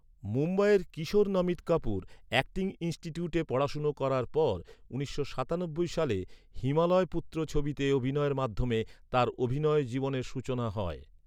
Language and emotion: Bengali, neutral